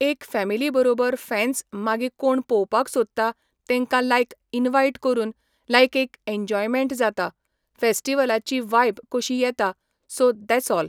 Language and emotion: Goan Konkani, neutral